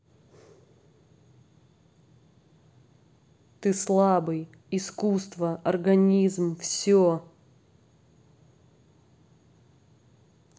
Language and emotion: Russian, angry